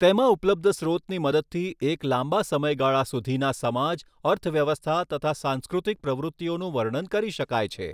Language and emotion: Gujarati, neutral